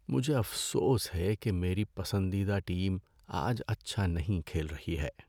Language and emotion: Urdu, sad